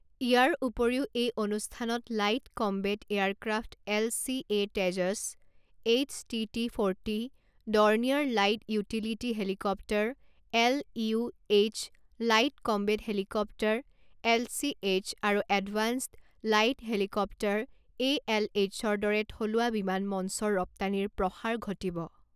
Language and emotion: Assamese, neutral